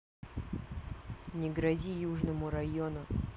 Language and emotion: Russian, neutral